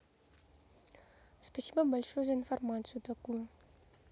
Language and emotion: Russian, neutral